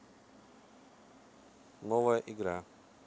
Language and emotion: Russian, neutral